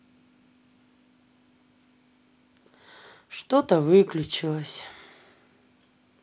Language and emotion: Russian, sad